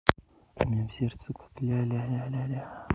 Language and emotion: Russian, positive